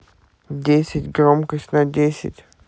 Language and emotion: Russian, neutral